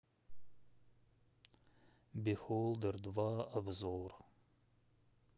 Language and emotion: Russian, sad